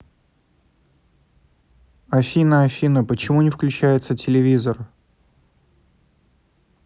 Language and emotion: Russian, neutral